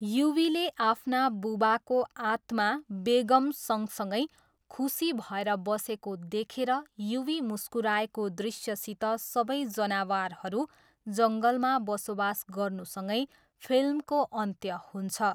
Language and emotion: Nepali, neutral